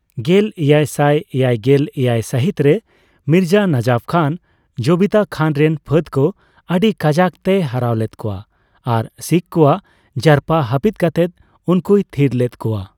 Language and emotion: Santali, neutral